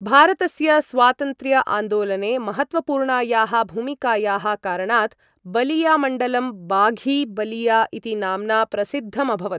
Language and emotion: Sanskrit, neutral